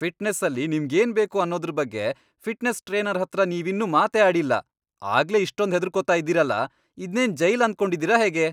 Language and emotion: Kannada, angry